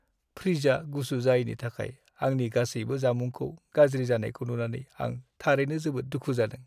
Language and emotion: Bodo, sad